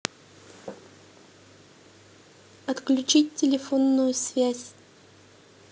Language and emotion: Russian, neutral